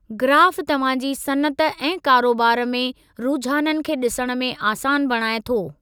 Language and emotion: Sindhi, neutral